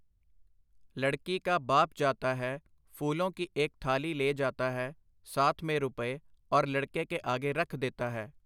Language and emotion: Punjabi, neutral